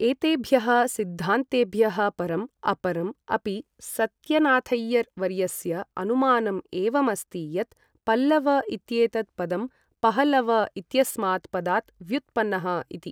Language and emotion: Sanskrit, neutral